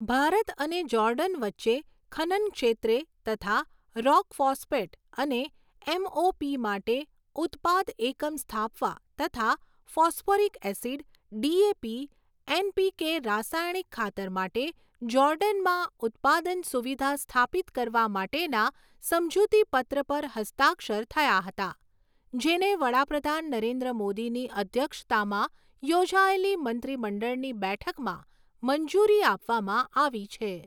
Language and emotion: Gujarati, neutral